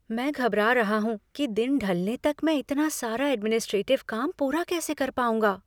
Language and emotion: Hindi, fearful